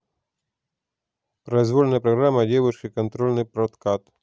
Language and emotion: Russian, neutral